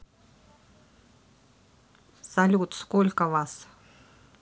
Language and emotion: Russian, neutral